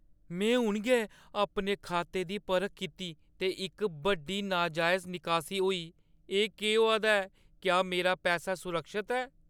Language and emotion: Dogri, fearful